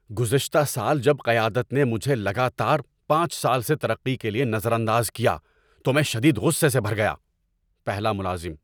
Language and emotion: Urdu, angry